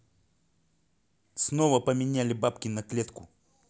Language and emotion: Russian, angry